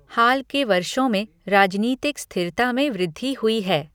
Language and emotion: Hindi, neutral